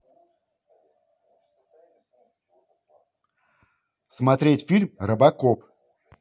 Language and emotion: Russian, positive